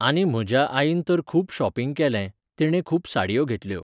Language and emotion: Goan Konkani, neutral